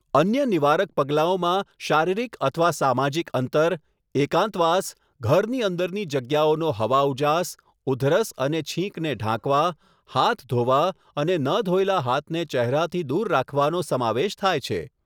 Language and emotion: Gujarati, neutral